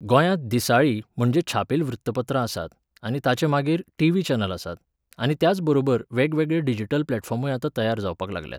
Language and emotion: Goan Konkani, neutral